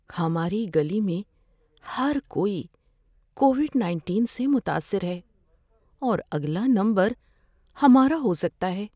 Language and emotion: Urdu, fearful